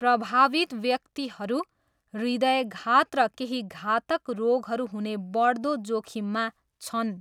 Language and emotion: Nepali, neutral